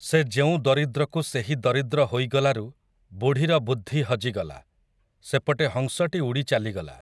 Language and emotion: Odia, neutral